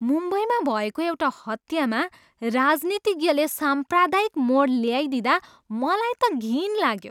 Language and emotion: Nepali, disgusted